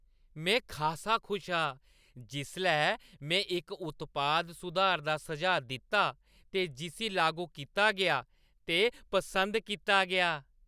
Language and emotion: Dogri, happy